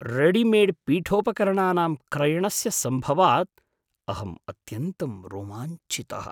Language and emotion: Sanskrit, surprised